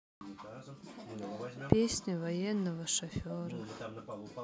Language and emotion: Russian, sad